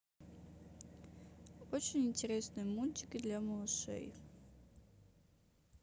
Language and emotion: Russian, neutral